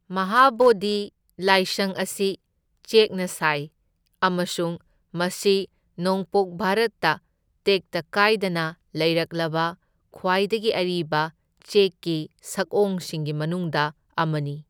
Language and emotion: Manipuri, neutral